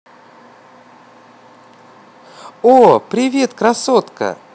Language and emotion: Russian, positive